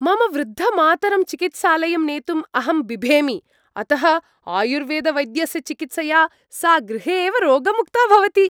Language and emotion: Sanskrit, happy